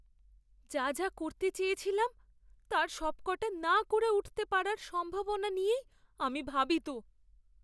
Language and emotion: Bengali, fearful